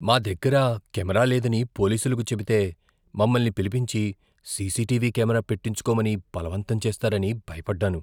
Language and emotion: Telugu, fearful